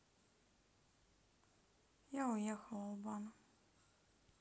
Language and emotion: Russian, sad